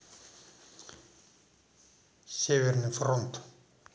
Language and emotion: Russian, neutral